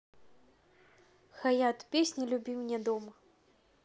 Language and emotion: Russian, neutral